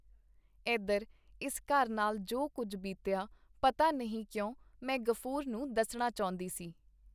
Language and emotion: Punjabi, neutral